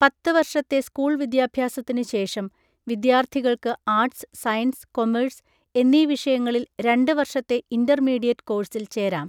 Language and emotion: Malayalam, neutral